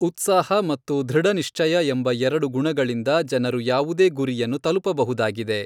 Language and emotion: Kannada, neutral